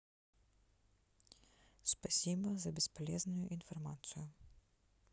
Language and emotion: Russian, neutral